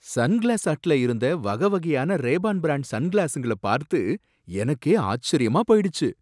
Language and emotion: Tamil, surprised